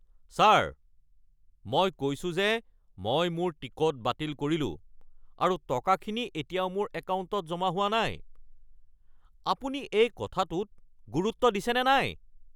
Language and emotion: Assamese, angry